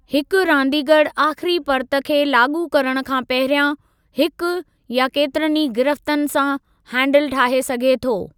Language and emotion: Sindhi, neutral